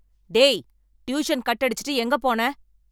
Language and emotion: Tamil, angry